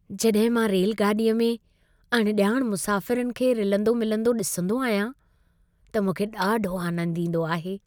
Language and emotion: Sindhi, happy